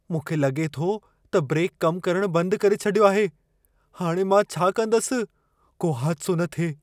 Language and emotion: Sindhi, fearful